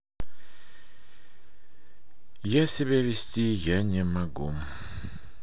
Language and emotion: Russian, sad